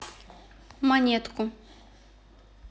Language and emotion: Russian, neutral